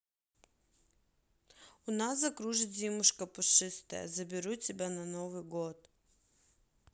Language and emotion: Russian, neutral